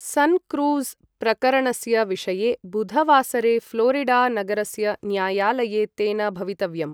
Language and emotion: Sanskrit, neutral